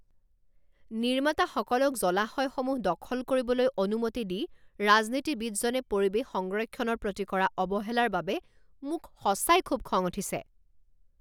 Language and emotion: Assamese, angry